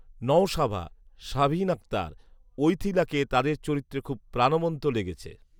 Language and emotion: Bengali, neutral